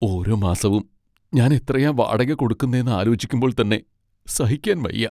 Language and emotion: Malayalam, sad